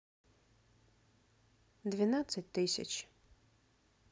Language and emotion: Russian, neutral